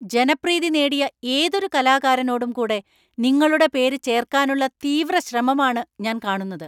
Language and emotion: Malayalam, angry